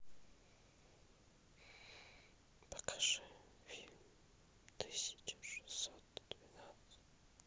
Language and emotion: Russian, neutral